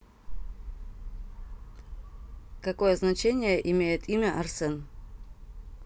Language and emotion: Russian, neutral